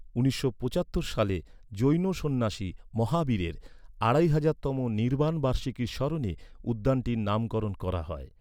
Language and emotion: Bengali, neutral